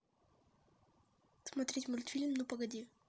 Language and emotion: Russian, neutral